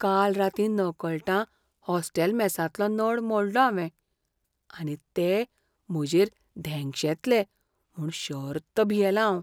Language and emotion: Goan Konkani, fearful